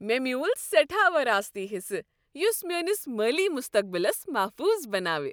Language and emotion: Kashmiri, happy